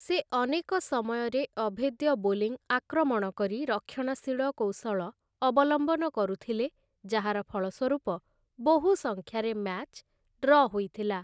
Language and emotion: Odia, neutral